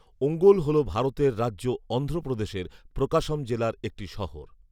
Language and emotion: Bengali, neutral